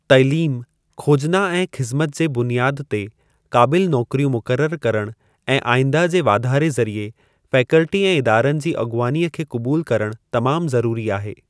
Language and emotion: Sindhi, neutral